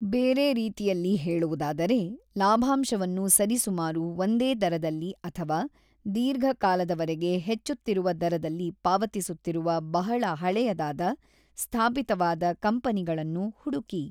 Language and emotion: Kannada, neutral